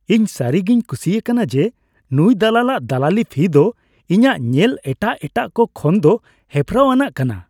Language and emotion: Santali, happy